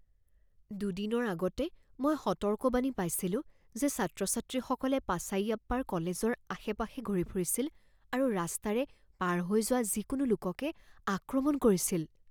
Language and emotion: Assamese, fearful